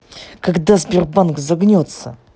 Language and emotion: Russian, angry